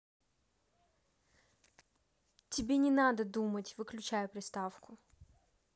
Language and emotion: Russian, neutral